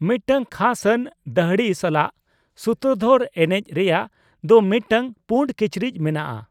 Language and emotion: Santali, neutral